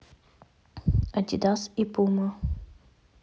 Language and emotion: Russian, neutral